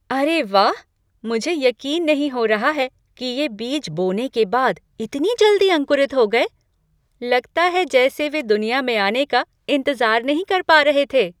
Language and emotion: Hindi, surprised